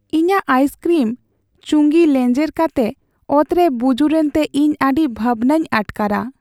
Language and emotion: Santali, sad